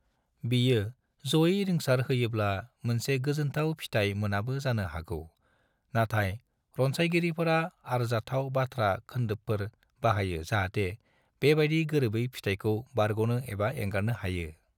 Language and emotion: Bodo, neutral